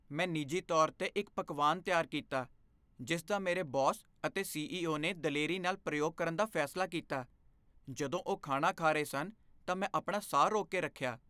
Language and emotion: Punjabi, fearful